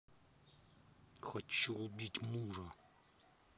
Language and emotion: Russian, angry